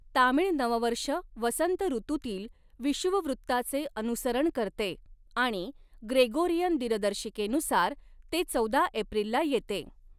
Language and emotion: Marathi, neutral